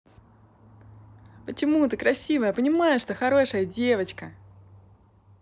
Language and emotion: Russian, positive